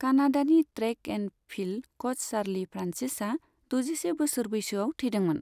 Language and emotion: Bodo, neutral